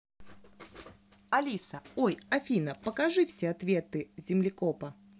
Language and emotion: Russian, positive